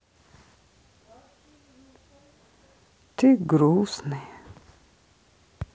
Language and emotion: Russian, sad